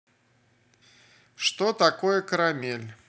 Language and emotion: Russian, neutral